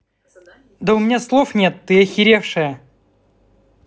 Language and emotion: Russian, angry